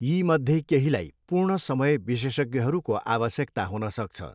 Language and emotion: Nepali, neutral